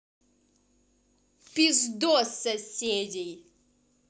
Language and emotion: Russian, angry